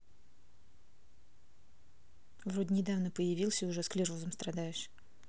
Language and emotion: Russian, neutral